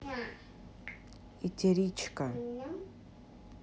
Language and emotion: Russian, neutral